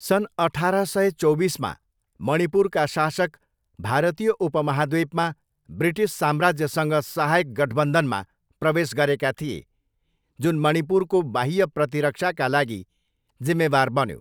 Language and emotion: Nepali, neutral